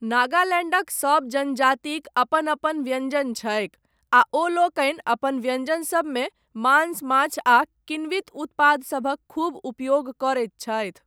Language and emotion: Maithili, neutral